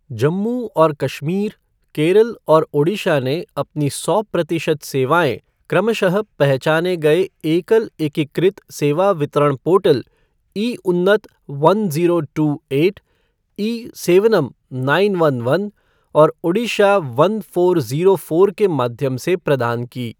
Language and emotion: Hindi, neutral